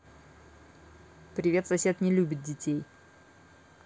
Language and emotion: Russian, neutral